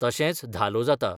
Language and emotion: Goan Konkani, neutral